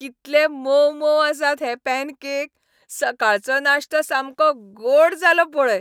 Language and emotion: Goan Konkani, happy